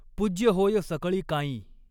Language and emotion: Marathi, neutral